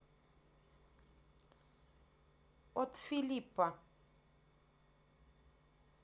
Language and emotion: Russian, neutral